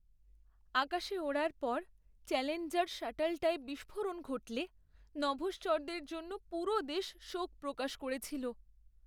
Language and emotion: Bengali, sad